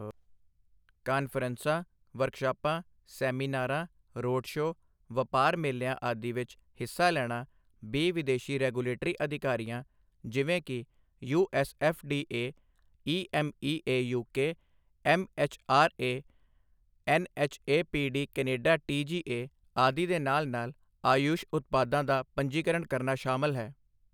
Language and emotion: Punjabi, neutral